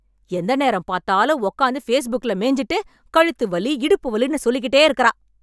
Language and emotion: Tamil, angry